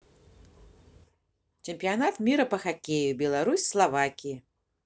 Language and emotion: Russian, positive